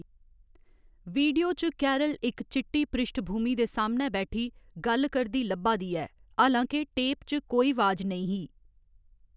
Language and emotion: Dogri, neutral